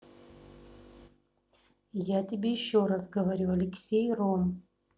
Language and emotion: Russian, angry